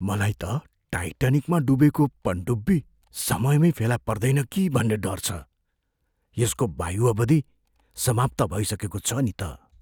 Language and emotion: Nepali, fearful